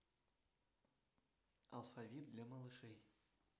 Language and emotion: Russian, neutral